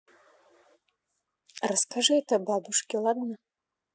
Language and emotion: Russian, neutral